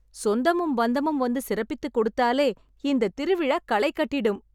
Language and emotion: Tamil, happy